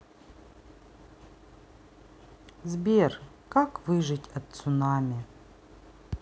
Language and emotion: Russian, sad